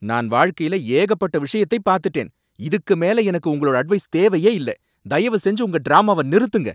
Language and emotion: Tamil, angry